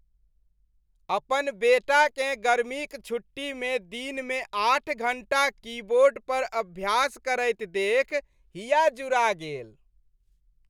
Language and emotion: Maithili, happy